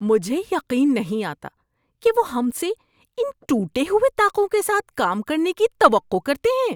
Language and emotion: Urdu, disgusted